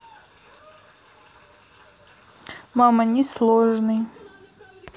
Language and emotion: Russian, neutral